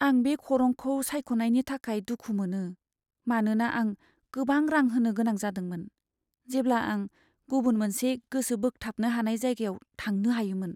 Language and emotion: Bodo, sad